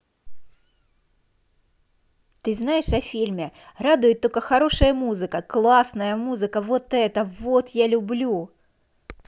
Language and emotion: Russian, positive